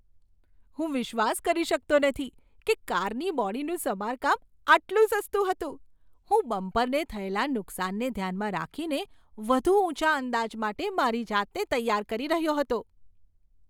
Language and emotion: Gujarati, surprised